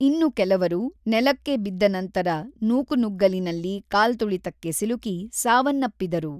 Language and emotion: Kannada, neutral